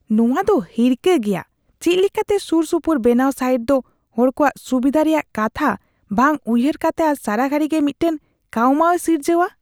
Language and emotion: Santali, disgusted